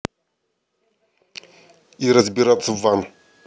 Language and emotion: Russian, angry